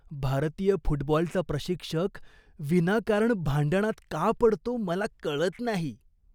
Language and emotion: Marathi, disgusted